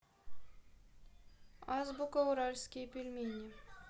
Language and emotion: Russian, neutral